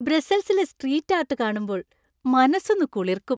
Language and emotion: Malayalam, happy